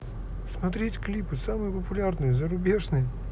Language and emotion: Russian, neutral